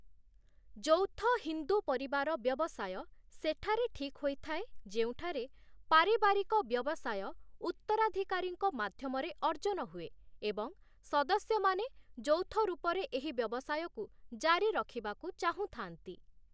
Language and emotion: Odia, neutral